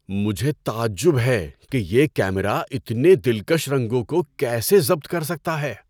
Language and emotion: Urdu, surprised